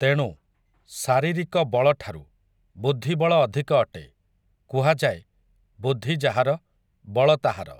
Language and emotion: Odia, neutral